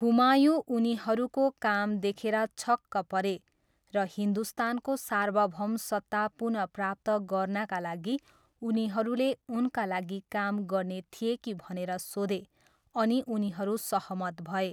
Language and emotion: Nepali, neutral